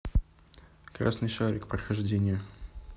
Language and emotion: Russian, neutral